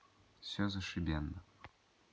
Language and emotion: Russian, neutral